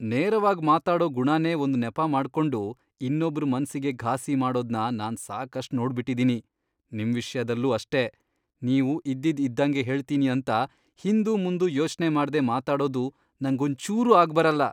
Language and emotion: Kannada, disgusted